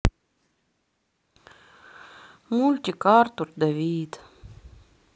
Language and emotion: Russian, sad